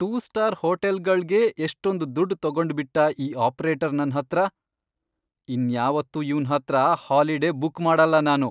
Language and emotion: Kannada, angry